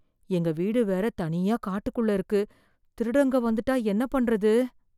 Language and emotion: Tamil, fearful